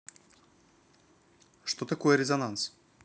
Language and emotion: Russian, neutral